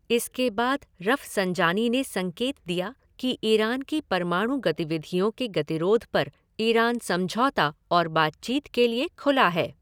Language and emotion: Hindi, neutral